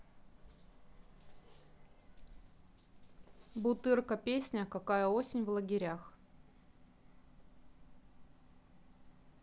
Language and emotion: Russian, neutral